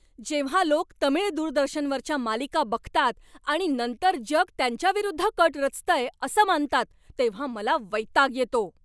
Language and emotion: Marathi, angry